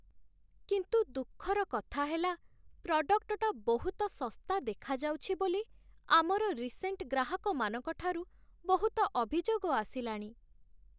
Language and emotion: Odia, sad